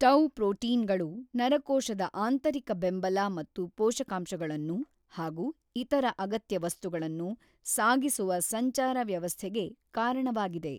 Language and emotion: Kannada, neutral